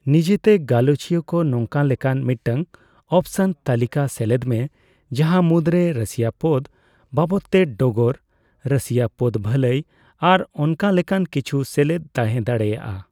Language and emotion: Santali, neutral